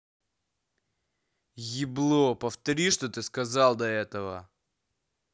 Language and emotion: Russian, angry